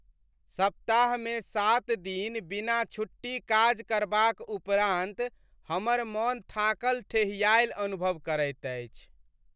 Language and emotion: Maithili, sad